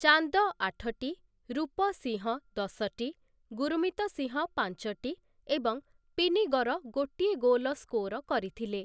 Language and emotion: Odia, neutral